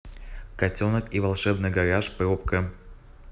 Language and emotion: Russian, neutral